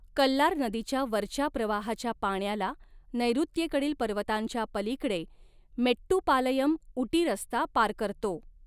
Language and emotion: Marathi, neutral